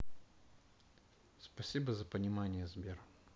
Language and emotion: Russian, sad